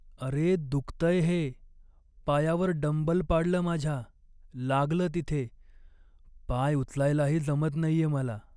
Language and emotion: Marathi, sad